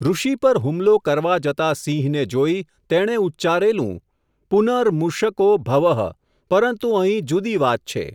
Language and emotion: Gujarati, neutral